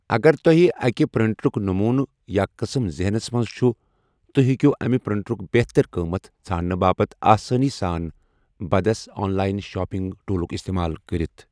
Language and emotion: Kashmiri, neutral